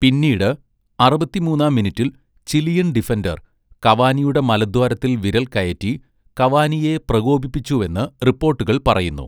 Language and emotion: Malayalam, neutral